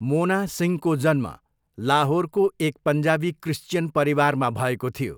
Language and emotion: Nepali, neutral